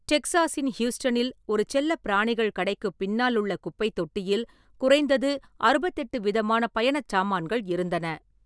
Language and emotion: Tamil, neutral